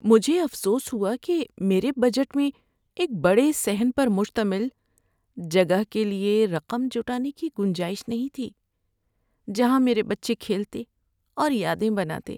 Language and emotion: Urdu, sad